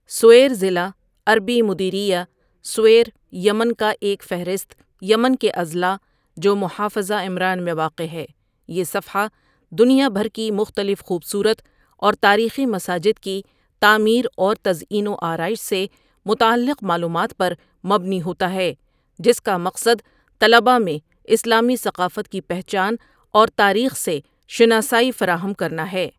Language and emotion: Urdu, neutral